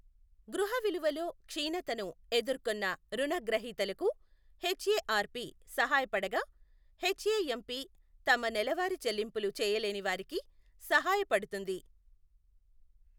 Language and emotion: Telugu, neutral